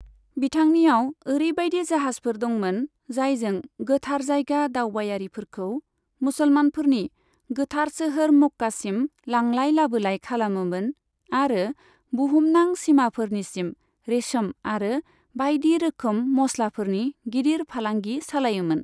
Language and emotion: Bodo, neutral